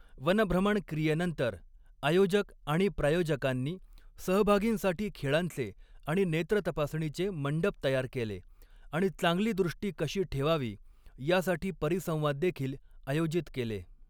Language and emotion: Marathi, neutral